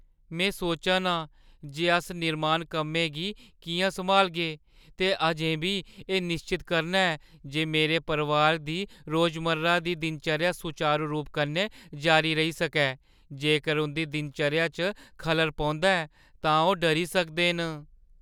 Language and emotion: Dogri, fearful